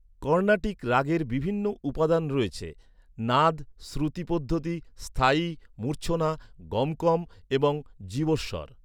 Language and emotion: Bengali, neutral